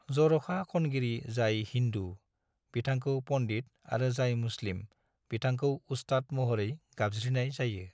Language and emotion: Bodo, neutral